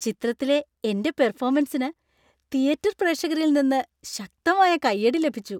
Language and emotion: Malayalam, happy